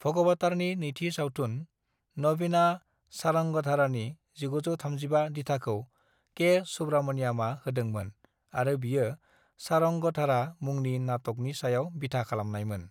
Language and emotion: Bodo, neutral